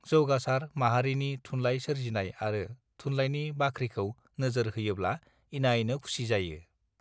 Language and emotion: Bodo, neutral